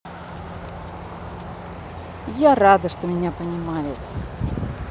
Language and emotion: Russian, positive